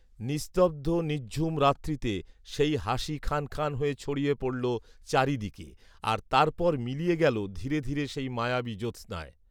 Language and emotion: Bengali, neutral